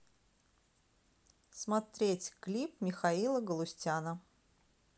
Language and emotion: Russian, neutral